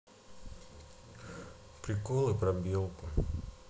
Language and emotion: Russian, sad